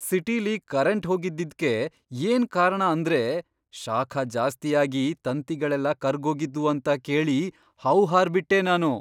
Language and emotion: Kannada, surprised